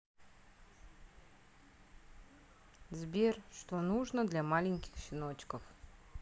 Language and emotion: Russian, neutral